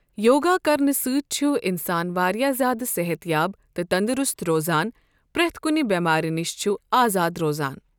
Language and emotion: Kashmiri, neutral